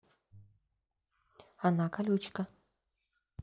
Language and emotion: Russian, neutral